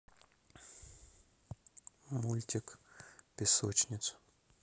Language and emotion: Russian, neutral